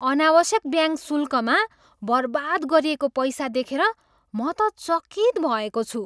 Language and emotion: Nepali, surprised